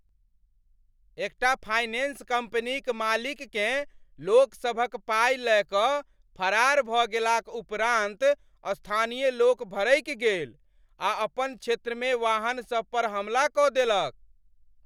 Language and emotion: Maithili, angry